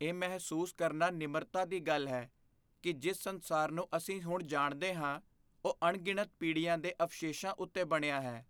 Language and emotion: Punjabi, fearful